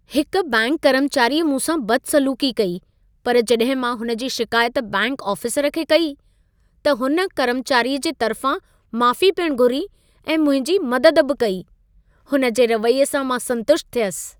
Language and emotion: Sindhi, happy